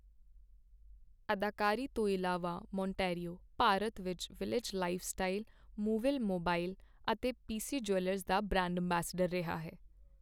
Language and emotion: Punjabi, neutral